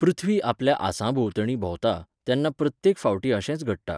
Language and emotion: Goan Konkani, neutral